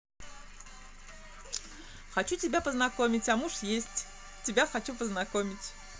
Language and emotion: Russian, positive